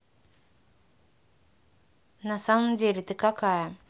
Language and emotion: Russian, neutral